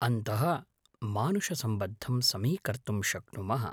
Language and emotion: Sanskrit, neutral